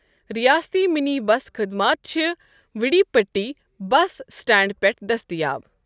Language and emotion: Kashmiri, neutral